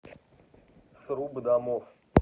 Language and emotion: Russian, neutral